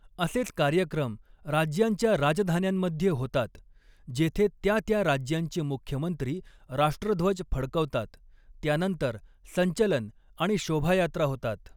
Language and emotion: Marathi, neutral